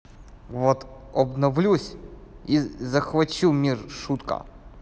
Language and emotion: Russian, neutral